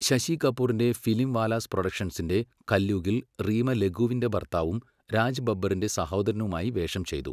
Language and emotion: Malayalam, neutral